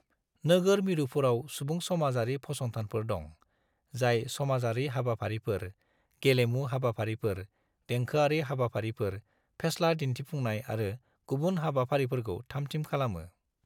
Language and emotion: Bodo, neutral